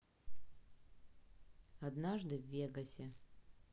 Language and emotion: Russian, neutral